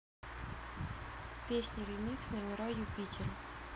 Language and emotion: Russian, neutral